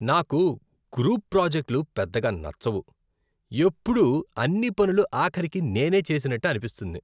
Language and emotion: Telugu, disgusted